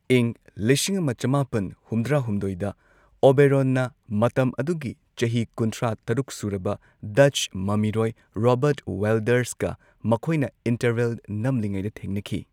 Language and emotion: Manipuri, neutral